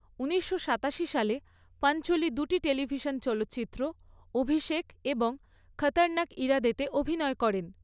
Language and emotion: Bengali, neutral